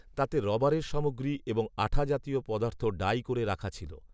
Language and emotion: Bengali, neutral